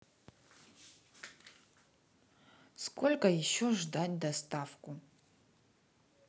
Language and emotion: Russian, neutral